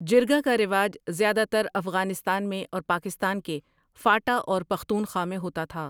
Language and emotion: Urdu, neutral